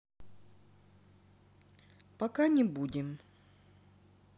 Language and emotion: Russian, neutral